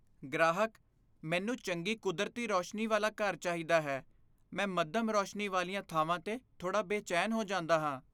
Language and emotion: Punjabi, fearful